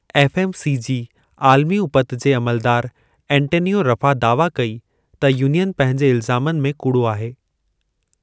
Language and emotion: Sindhi, neutral